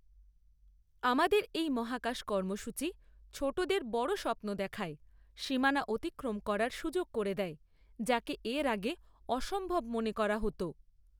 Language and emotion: Bengali, neutral